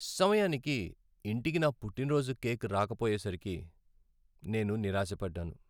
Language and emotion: Telugu, sad